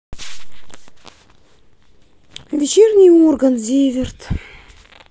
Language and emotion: Russian, sad